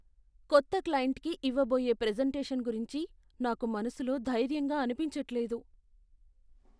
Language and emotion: Telugu, fearful